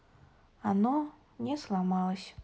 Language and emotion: Russian, sad